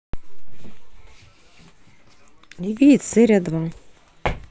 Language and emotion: Russian, neutral